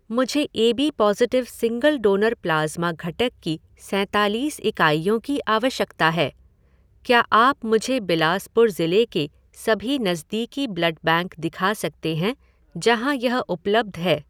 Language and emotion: Hindi, neutral